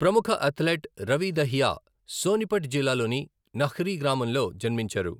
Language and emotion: Telugu, neutral